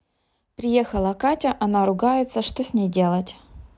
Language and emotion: Russian, neutral